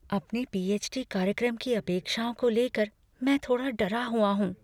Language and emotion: Hindi, fearful